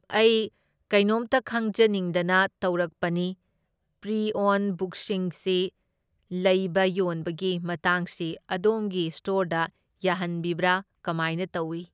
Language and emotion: Manipuri, neutral